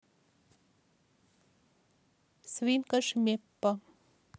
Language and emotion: Russian, neutral